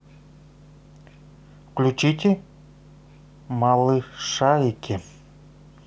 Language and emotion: Russian, neutral